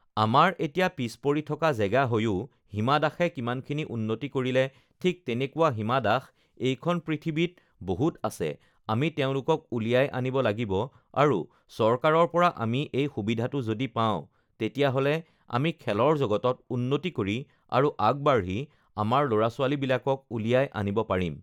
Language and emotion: Assamese, neutral